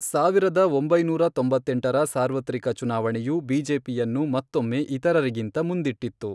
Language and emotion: Kannada, neutral